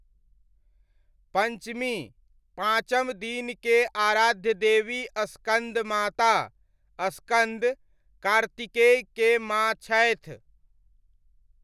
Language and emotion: Maithili, neutral